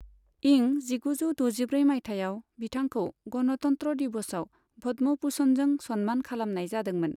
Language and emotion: Bodo, neutral